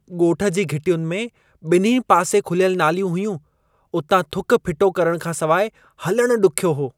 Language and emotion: Sindhi, disgusted